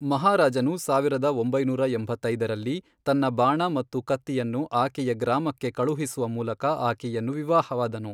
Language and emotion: Kannada, neutral